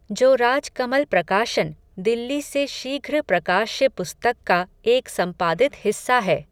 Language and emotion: Hindi, neutral